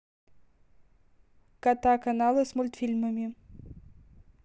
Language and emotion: Russian, neutral